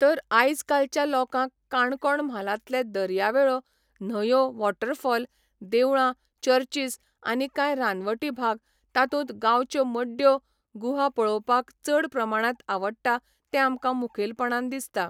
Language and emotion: Goan Konkani, neutral